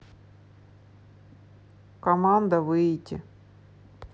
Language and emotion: Russian, neutral